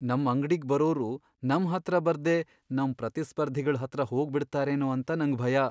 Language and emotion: Kannada, fearful